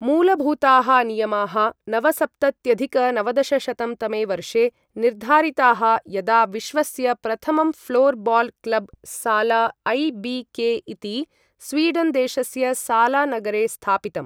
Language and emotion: Sanskrit, neutral